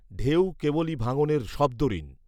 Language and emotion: Bengali, neutral